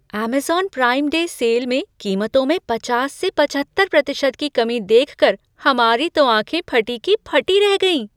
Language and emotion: Hindi, surprised